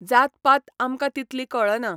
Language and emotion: Goan Konkani, neutral